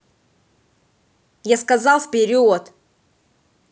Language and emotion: Russian, angry